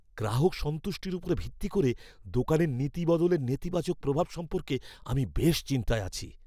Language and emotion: Bengali, fearful